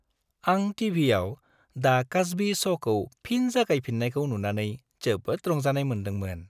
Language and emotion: Bodo, happy